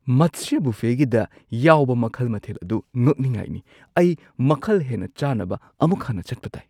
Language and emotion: Manipuri, surprised